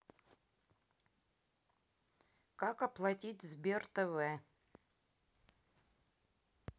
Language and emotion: Russian, neutral